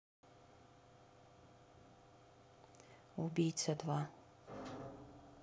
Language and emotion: Russian, neutral